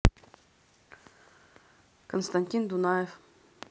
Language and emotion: Russian, neutral